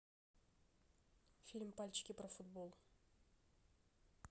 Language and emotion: Russian, neutral